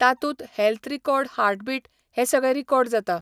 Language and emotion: Goan Konkani, neutral